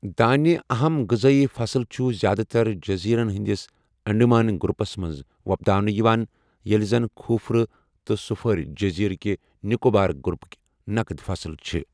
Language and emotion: Kashmiri, neutral